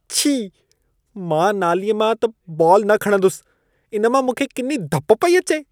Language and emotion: Sindhi, disgusted